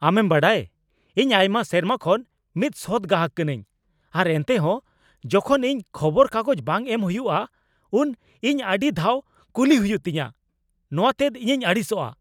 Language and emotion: Santali, angry